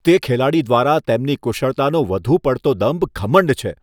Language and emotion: Gujarati, disgusted